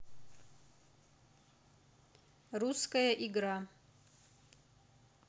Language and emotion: Russian, neutral